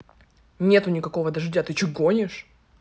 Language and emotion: Russian, angry